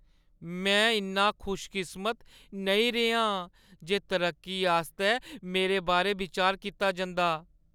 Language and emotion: Dogri, sad